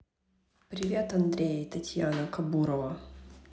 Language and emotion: Russian, neutral